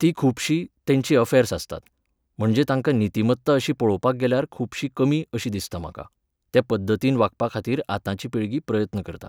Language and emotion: Goan Konkani, neutral